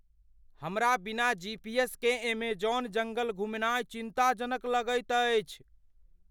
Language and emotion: Maithili, fearful